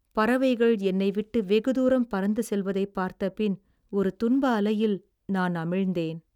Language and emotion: Tamil, sad